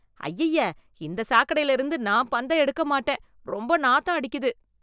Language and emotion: Tamil, disgusted